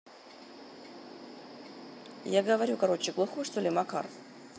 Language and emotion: Russian, neutral